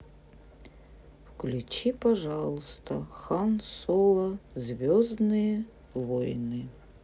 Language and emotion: Russian, sad